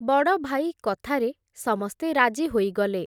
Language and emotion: Odia, neutral